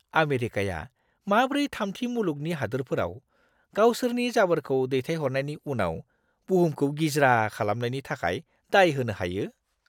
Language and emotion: Bodo, disgusted